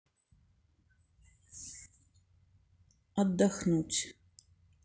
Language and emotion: Russian, sad